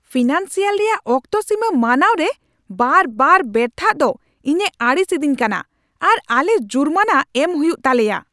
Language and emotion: Santali, angry